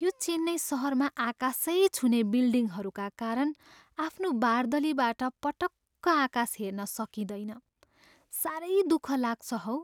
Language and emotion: Nepali, sad